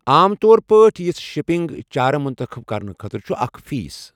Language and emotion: Kashmiri, neutral